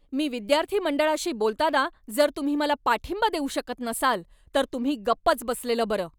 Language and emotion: Marathi, angry